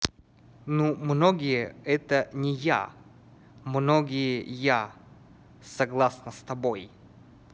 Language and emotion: Russian, neutral